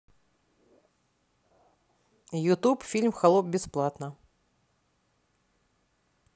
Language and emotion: Russian, neutral